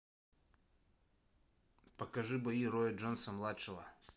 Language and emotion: Russian, neutral